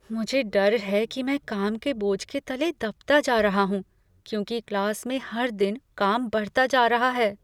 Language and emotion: Hindi, fearful